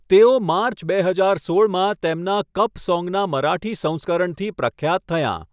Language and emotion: Gujarati, neutral